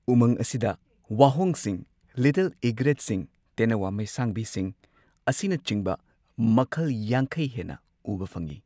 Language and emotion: Manipuri, neutral